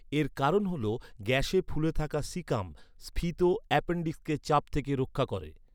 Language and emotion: Bengali, neutral